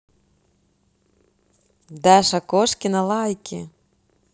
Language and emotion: Russian, positive